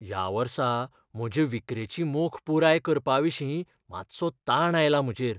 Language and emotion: Goan Konkani, fearful